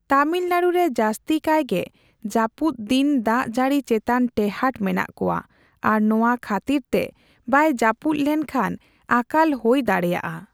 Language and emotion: Santali, neutral